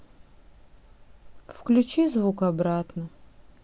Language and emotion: Russian, sad